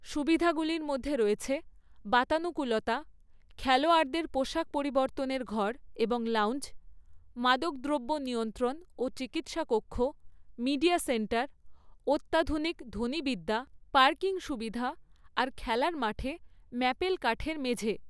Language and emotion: Bengali, neutral